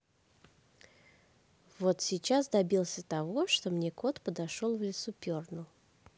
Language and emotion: Russian, neutral